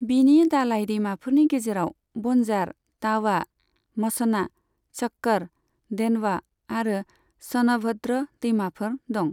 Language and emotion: Bodo, neutral